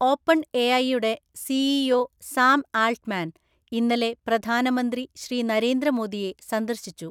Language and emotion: Malayalam, neutral